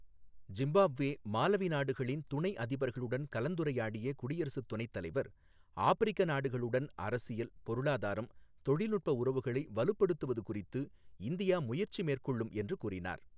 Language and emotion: Tamil, neutral